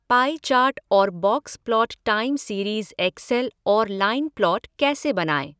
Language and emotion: Hindi, neutral